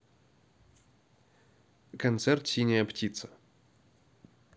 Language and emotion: Russian, neutral